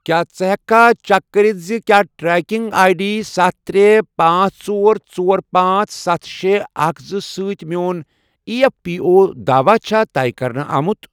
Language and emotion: Kashmiri, neutral